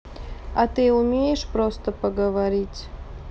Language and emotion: Russian, sad